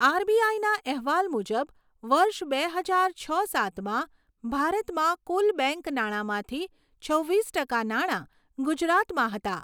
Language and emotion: Gujarati, neutral